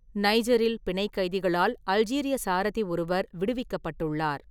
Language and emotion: Tamil, neutral